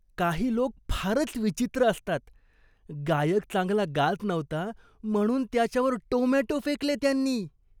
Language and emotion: Marathi, disgusted